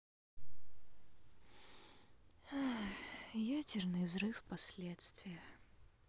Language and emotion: Russian, sad